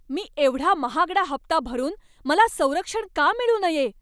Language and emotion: Marathi, angry